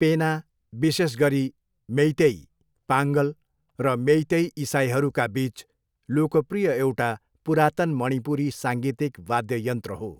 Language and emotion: Nepali, neutral